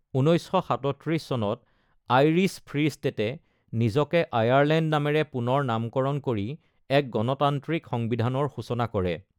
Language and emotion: Assamese, neutral